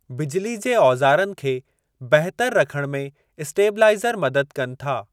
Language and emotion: Sindhi, neutral